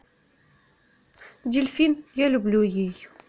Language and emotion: Russian, neutral